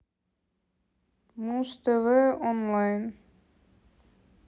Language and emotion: Russian, neutral